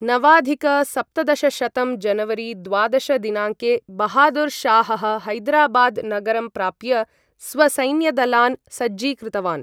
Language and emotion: Sanskrit, neutral